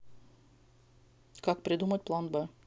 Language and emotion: Russian, neutral